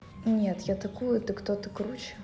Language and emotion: Russian, neutral